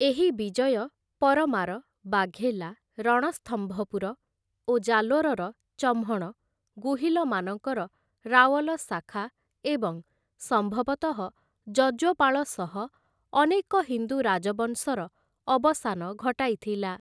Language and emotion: Odia, neutral